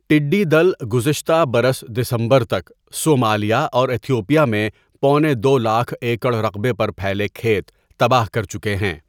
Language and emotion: Urdu, neutral